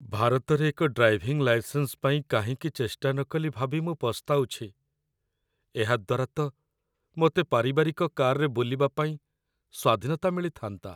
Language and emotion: Odia, sad